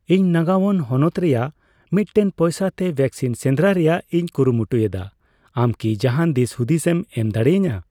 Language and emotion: Santali, neutral